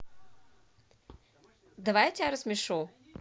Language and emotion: Russian, positive